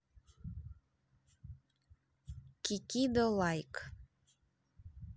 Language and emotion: Russian, neutral